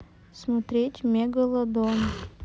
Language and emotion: Russian, sad